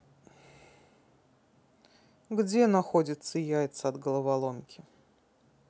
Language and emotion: Russian, neutral